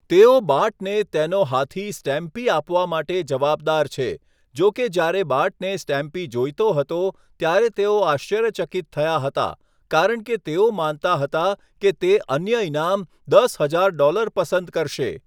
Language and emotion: Gujarati, neutral